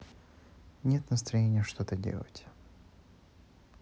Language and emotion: Russian, sad